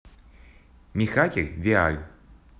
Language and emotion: Russian, positive